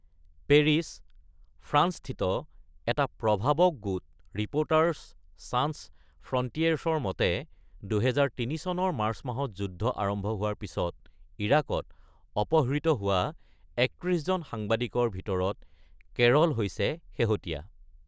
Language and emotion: Assamese, neutral